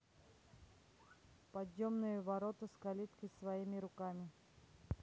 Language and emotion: Russian, neutral